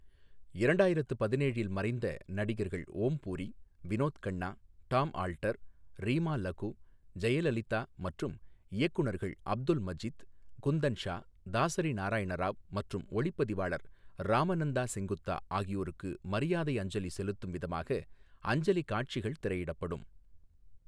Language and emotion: Tamil, neutral